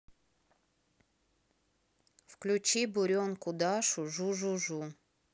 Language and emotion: Russian, neutral